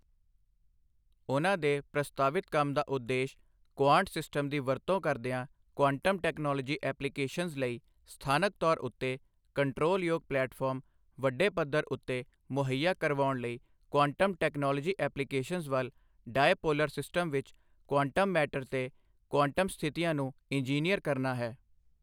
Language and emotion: Punjabi, neutral